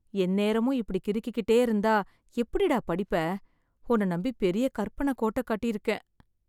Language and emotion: Tamil, sad